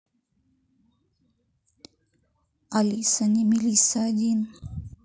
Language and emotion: Russian, neutral